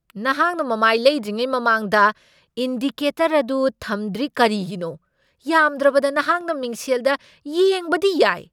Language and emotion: Manipuri, angry